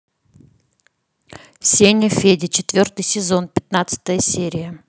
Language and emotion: Russian, neutral